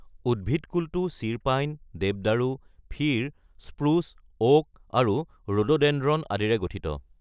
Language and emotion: Assamese, neutral